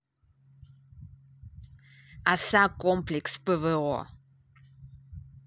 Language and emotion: Russian, neutral